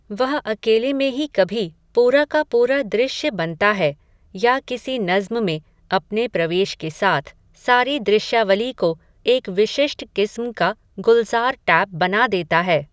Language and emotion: Hindi, neutral